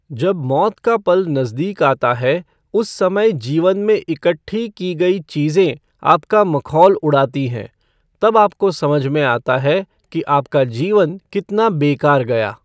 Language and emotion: Hindi, neutral